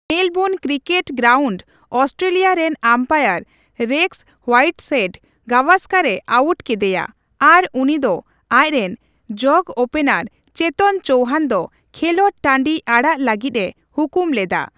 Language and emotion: Santali, neutral